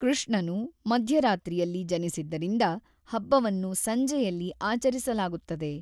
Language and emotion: Kannada, neutral